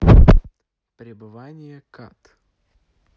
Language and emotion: Russian, neutral